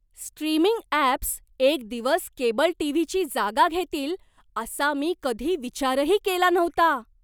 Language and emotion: Marathi, surprised